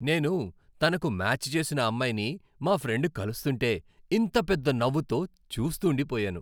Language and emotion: Telugu, happy